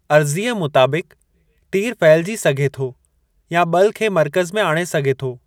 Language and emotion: Sindhi, neutral